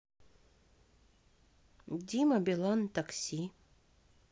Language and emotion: Russian, neutral